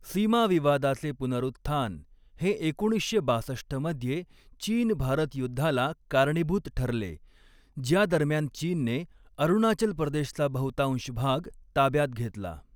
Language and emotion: Marathi, neutral